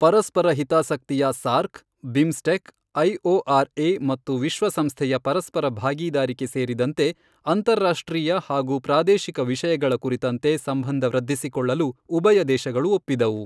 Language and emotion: Kannada, neutral